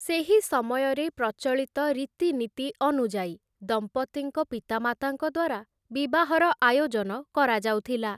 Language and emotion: Odia, neutral